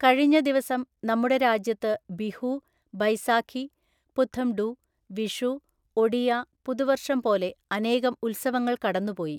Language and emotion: Malayalam, neutral